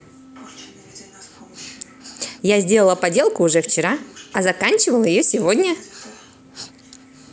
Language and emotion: Russian, positive